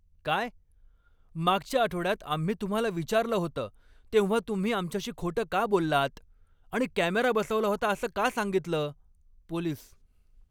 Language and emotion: Marathi, angry